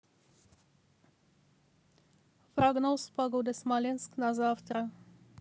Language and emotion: Russian, neutral